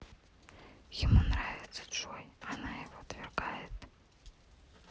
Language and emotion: Russian, neutral